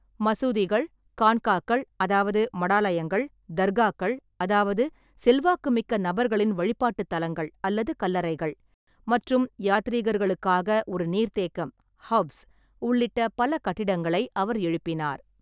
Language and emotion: Tamil, neutral